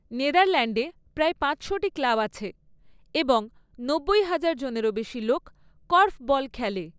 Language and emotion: Bengali, neutral